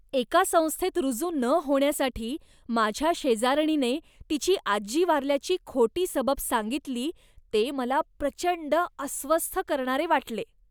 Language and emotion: Marathi, disgusted